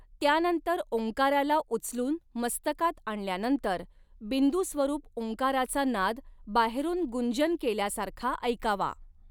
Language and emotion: Marathi, neutral